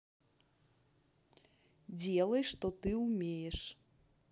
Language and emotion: Russian, neutral